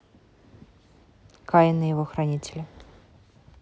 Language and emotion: Russian, neutral